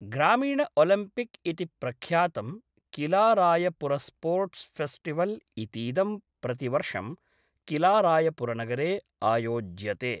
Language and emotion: Sanskrit, neutral